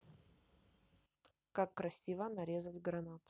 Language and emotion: Russian, neutral